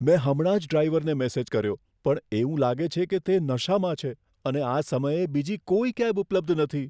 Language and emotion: Gujarati, fearful